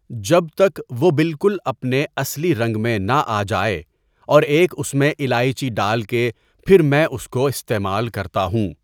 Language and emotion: Urdu, neutral